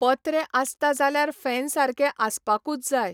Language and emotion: Goan Konkani, neutral